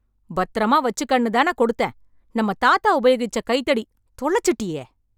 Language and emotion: Tamil, angry